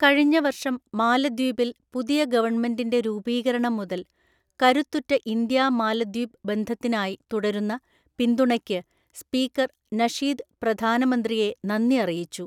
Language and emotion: Malayalam, neutral